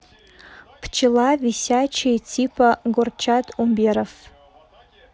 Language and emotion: Russian, neutral